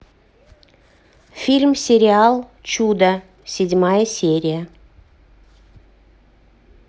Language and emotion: Russian, neutral